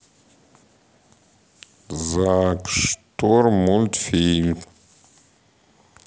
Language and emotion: Russian, neutral